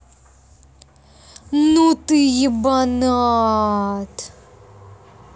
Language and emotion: Russian, angry